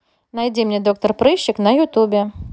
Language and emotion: Russian, neutral